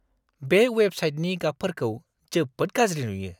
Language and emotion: Bodo, disgusted